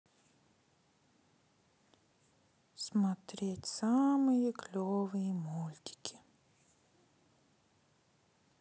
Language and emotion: Russian, sad